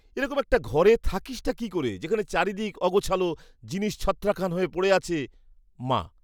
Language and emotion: Bengali, disgusted